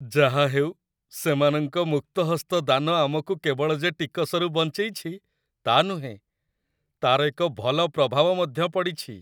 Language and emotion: Odia, happy